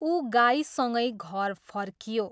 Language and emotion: Nepali, neutral